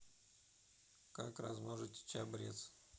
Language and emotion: Russian, neutral